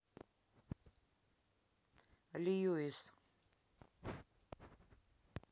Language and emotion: Russian, neutral